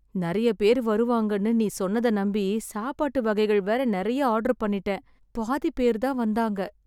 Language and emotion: Tamil, sad